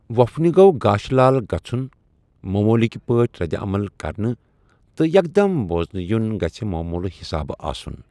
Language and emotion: Kashmiri, neutral